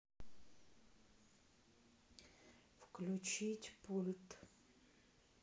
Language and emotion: Russian, neutral